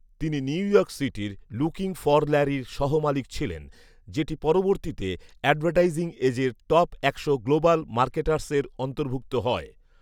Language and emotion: Bengali, neutral